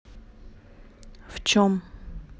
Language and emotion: Russian, neutral